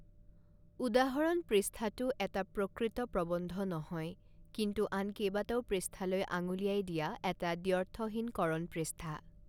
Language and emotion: Assamese, neutral